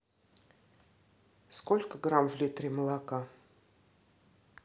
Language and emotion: Russian, neutral